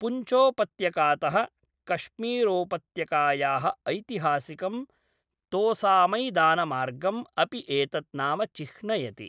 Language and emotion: Sanskrit, neutral